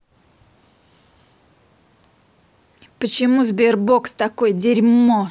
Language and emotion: Russian, angry